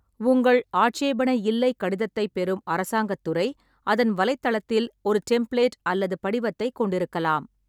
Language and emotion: Tamil, neutral